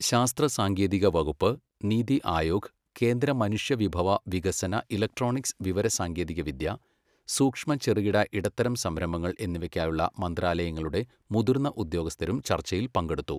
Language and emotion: Malayalam, neutral